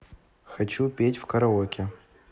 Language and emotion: Russian, neutral